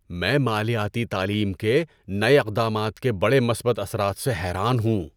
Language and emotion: Urdu, surprised